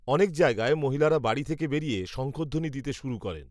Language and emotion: Bengali, neutral